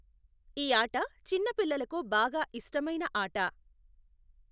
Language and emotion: Telugu, neutral